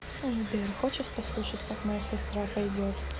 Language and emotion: Russian, neutral